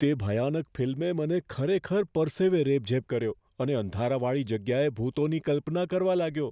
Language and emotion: Gujarati, fearful